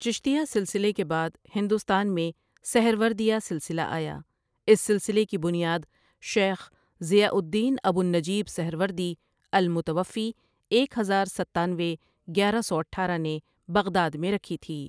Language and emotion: Urdu, neutral